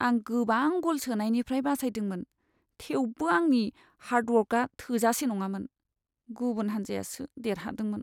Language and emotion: Bodo, sad